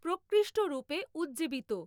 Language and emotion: Bengali, neutral